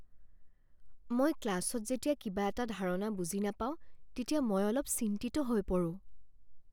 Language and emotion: Assamese, fearful